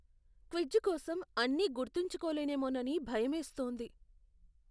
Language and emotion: Telugu, fearful